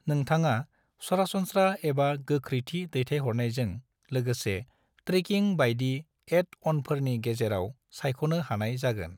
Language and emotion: Bodo, neutral